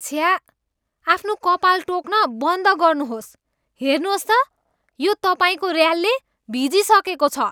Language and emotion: Nepali, disgusted